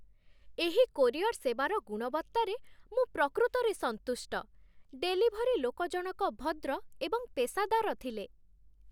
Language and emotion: Odia, happy